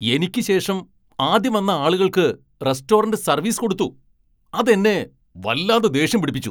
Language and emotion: Malayalam, angry